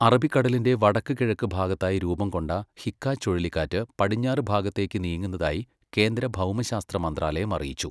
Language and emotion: Malayalam, neutral